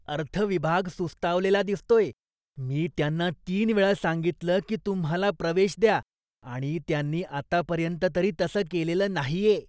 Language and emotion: Marathi, disgusted